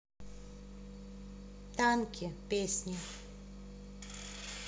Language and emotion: Russian, neutral